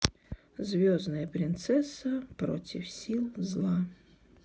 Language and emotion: Russian, neutral